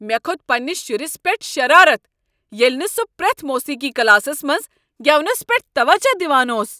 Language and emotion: Kashmiri, angry